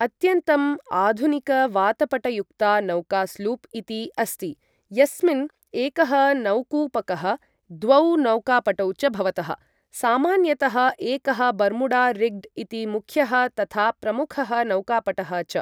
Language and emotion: Sanskrit, neutral